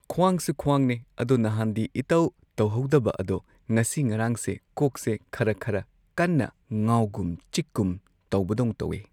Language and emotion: Manipuri, neutral